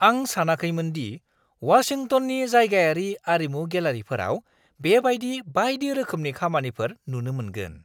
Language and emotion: Bodo, surprised